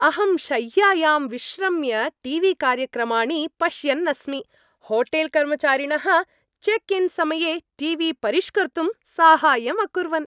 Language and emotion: Sanskrit, happy